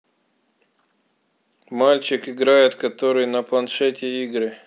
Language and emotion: Russian, neutral